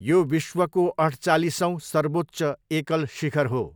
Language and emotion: Nepali, neutral